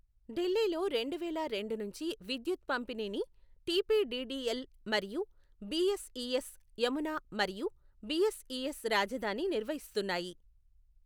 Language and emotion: Telugu, neutral